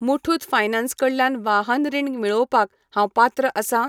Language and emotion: Goan Konkani, neutral